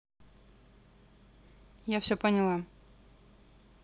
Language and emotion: Russian, neutral